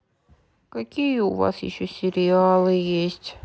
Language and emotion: Russian, sad